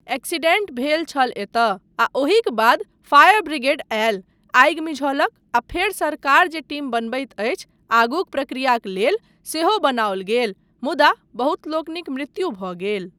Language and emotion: Maithili, neutral